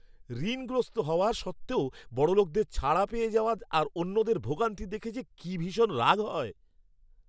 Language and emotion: Bengali, angry